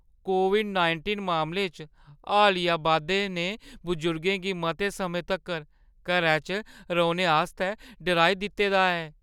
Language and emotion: Dogri, fearful